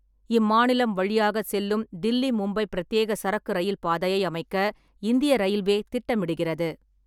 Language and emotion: Tamil, neutral